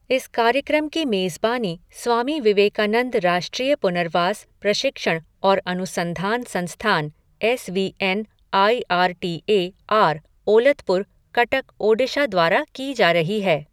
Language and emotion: Hindi, neutral